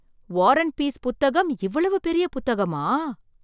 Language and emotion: Tamil, surprised